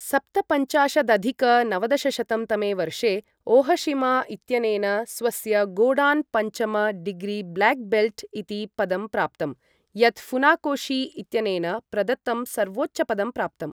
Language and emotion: Sanskrit, neutral